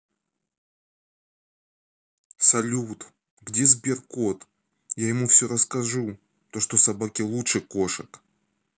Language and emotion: Russian, sad